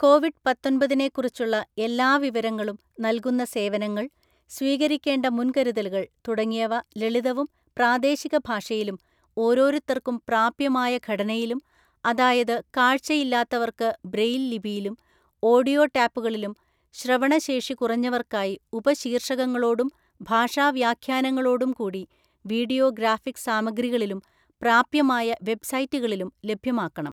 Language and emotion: Malayalam, neutral